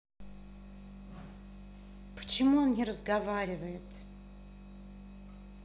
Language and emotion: Russian, angry